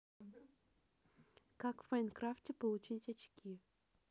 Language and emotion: Russian, neutral